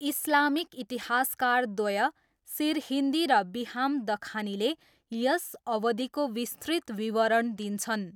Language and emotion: Nepali, neutral